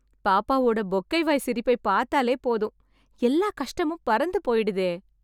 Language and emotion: Tamil, happy